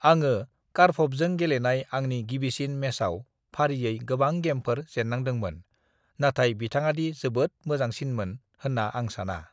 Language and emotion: Bodo, neutral